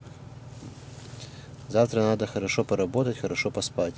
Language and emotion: Russian, neutral